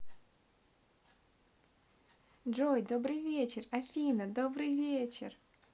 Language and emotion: Russian, positive